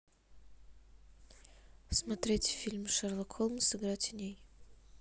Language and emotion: Russian, neutral